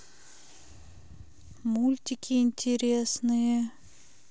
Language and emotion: Russian, sad